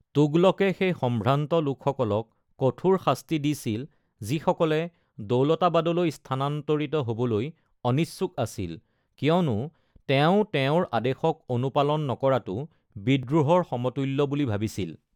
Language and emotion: Assamese, neutral